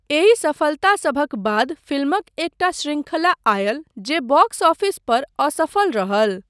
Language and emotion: Maithili, neutral